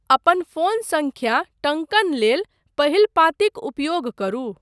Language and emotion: Maithili, neutral